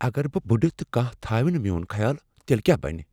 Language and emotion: Kashmiri, fearful